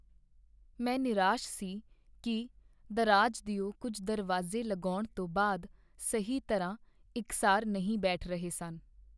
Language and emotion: Punjabi, sad